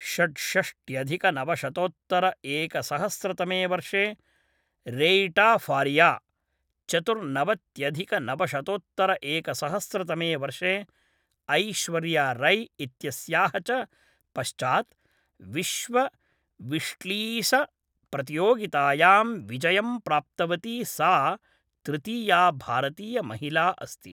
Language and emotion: Sanskrit, neutral